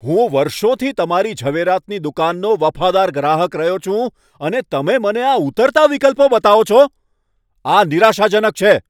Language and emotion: Gujarati, angry